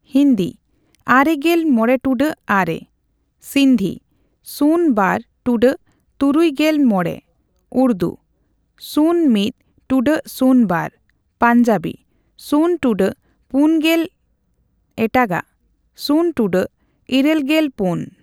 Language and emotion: Santali, neutral